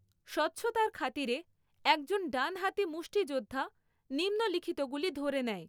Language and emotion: Bengali, neutral